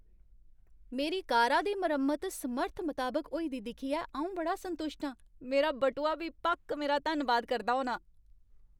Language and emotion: Dogri, happy